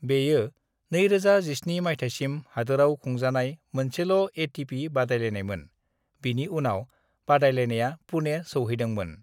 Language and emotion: Bodo, neutral